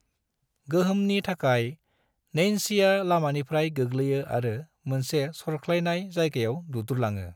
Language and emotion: Bodo, neutral